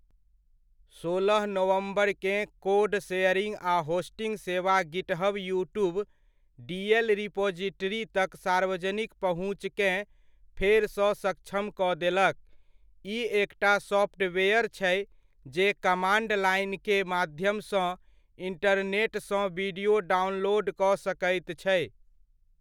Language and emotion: Maithili, neutral